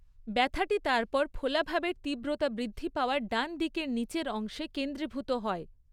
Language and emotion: Bengali, neutral